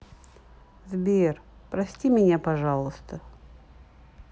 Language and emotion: Russian, sad